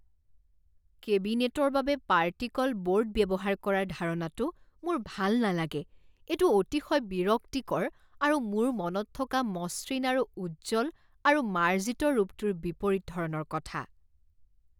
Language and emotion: Assamese, disgusted